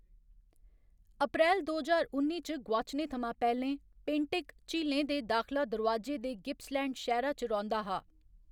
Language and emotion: Dogri, neutral